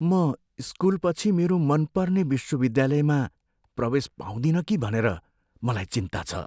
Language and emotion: Nepali, fearful